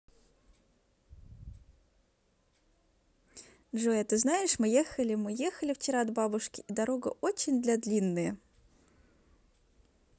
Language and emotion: Russian, positive